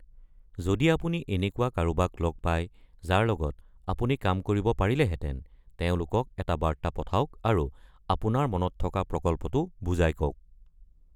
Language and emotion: Assamese, neutral